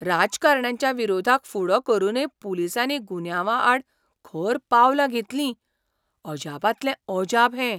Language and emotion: Goan Konkani, surprised